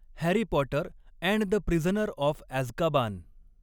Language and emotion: Marathi, neutral